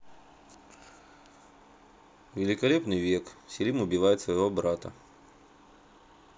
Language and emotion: Russian, neutral